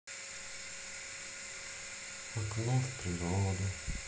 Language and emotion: Russian, sad